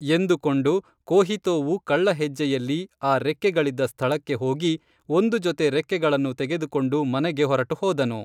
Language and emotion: Kannada, neutral